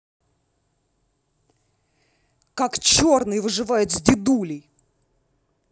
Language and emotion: Russian, angry